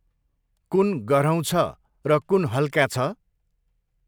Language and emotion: Nepali, neutral